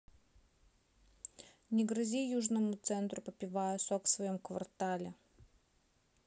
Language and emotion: Russian, neutral